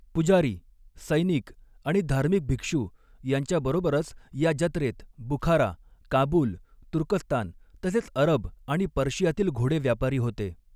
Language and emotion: Marathi, neutral